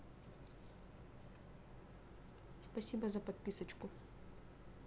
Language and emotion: Russian, neutral